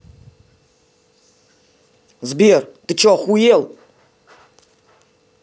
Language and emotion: Russian, angry